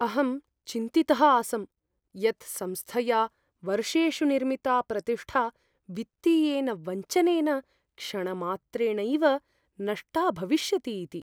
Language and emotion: Sanskrit, fearful